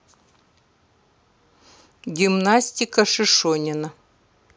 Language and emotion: Russian, neutral